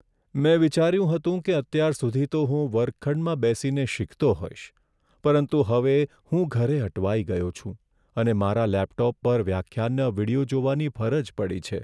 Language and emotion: Gujarati, sad